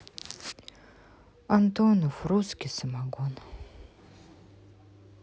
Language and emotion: Russian, sad